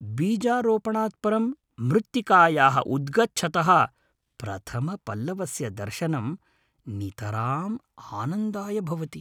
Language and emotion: Sanskrit, happy